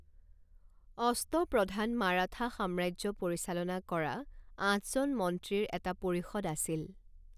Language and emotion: Assamese, neutral